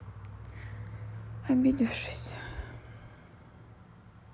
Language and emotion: Russian, sad